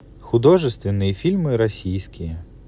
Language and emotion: Russian, neutral